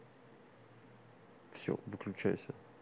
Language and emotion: Russian, neutral